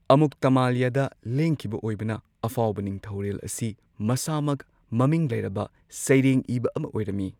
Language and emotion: Manipuri, neutral